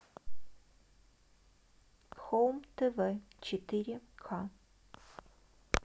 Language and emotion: Russian, neutral